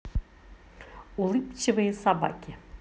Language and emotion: Russian, positive